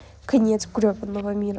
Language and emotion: Russian, sad